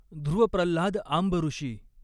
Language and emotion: Marathi, neutral